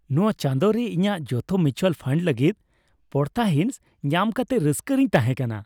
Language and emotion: Santali, happy